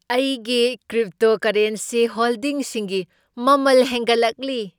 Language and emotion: Manipuri, happy